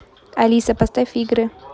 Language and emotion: Russian, neutral